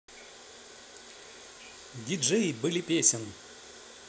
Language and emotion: Russian, positive